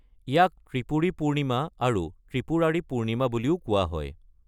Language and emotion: Assamese, neutral